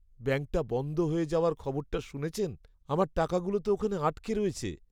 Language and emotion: Bengali, sad